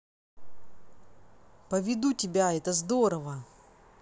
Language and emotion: Russian, positive